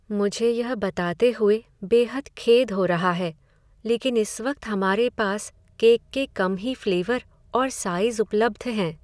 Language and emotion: Hindi, sad